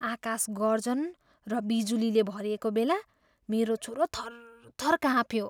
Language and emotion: Nepali, fearful